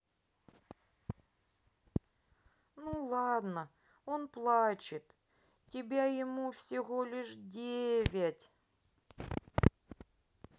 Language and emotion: Russian, sad